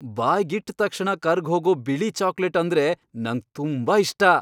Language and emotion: Kannada, happy